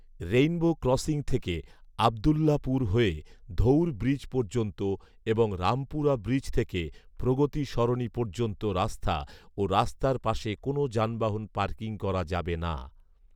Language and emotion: Bengali, neutral